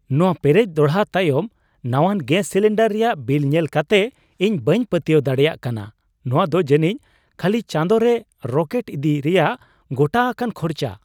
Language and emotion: Santali, surprised